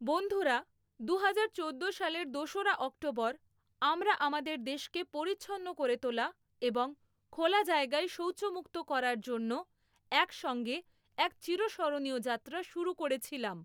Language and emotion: Bengali, neutral